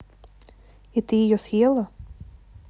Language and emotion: Russian, neutral